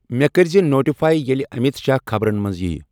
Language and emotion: Kashmiri, neutral